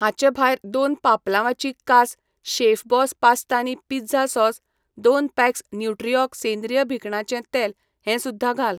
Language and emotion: Goan Konkani, neutral